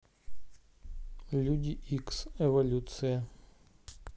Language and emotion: Russian, neutral